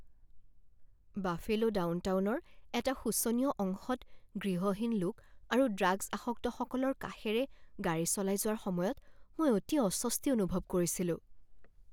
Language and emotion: Assamese, fearful